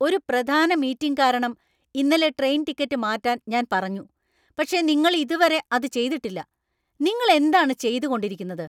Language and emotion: Malayalam, angry